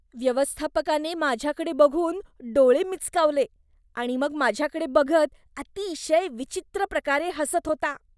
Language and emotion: Marathi, disgusted